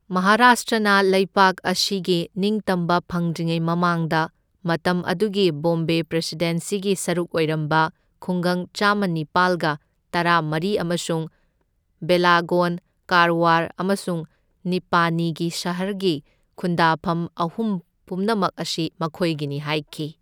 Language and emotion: Manipuri, neutral